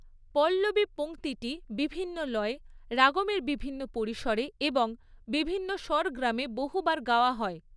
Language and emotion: Bengali, neutral